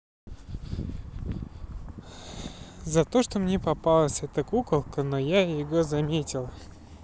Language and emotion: Russian, neutral